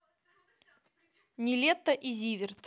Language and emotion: Russian, neutral